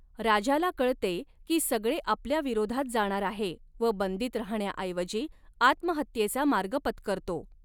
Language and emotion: Marathi, neutral